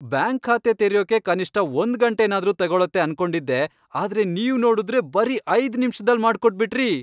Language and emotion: Kannada, happy